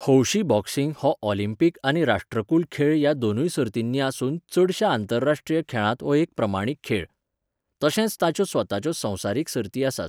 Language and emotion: Goan Konkani, neutral